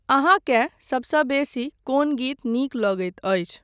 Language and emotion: Maithili, neutral